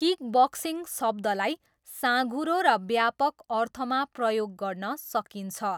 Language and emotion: Nepali, neutral